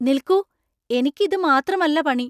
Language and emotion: Malayalam, surprised